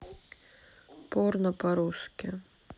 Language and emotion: Russian, neutral